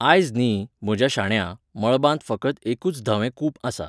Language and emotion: Goan Konkani, neutral